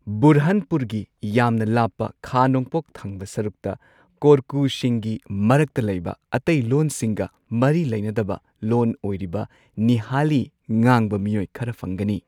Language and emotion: Manipuri, neutral